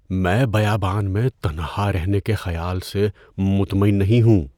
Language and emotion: Urdu, fearful